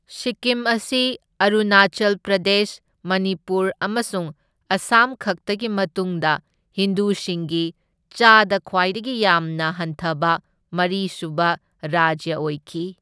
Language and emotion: Manipuri, neutral